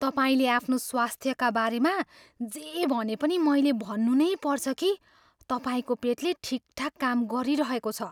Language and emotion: Nepali, surprised